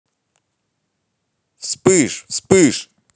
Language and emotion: Russian, positive